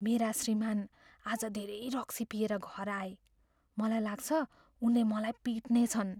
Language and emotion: Nepali, fearful